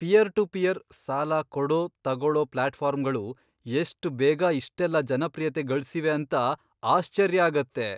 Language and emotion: Kannada, surprised